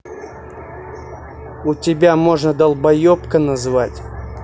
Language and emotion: Russian, angry